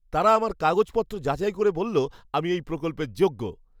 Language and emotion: Bengali, happy